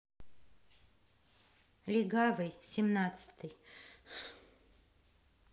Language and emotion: Russian, neutral